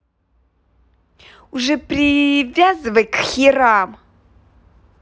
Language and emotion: Russian, angry